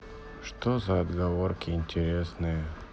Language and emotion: Russian, sad